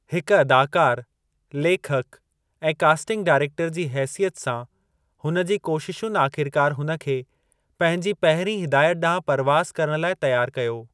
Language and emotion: Sindhi, neutral